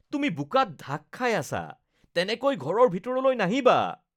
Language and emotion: Assamese, disgusted